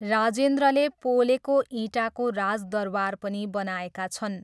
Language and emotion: Nepali, neutral